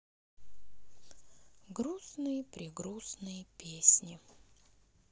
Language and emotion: Russian, sad